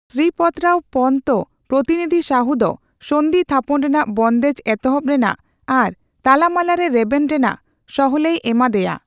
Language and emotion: Santali, neutral